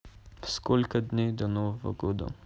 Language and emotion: Russian, neutral